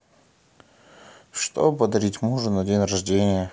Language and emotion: Russian, sad